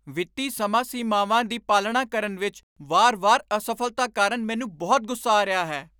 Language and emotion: Punjabi, angry